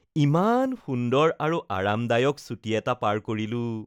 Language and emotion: Assamese, happy